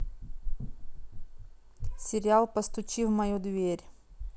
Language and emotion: Russian, neutral